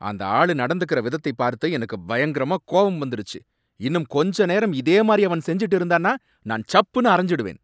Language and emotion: Tamil, angry